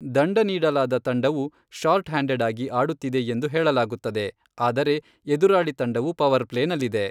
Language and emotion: Kannada, neutral